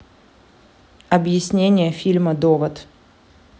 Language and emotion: Russian, neutral